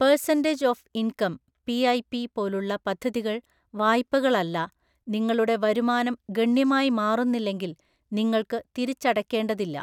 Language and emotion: Malayalam, neutral